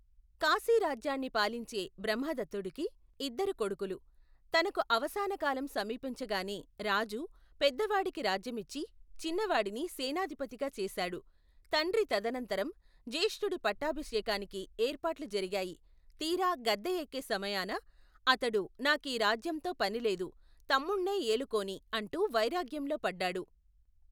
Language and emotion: Telugu, neutral